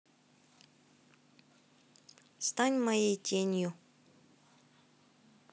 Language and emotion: Russian, neutral